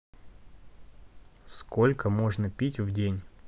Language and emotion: Russian, neutral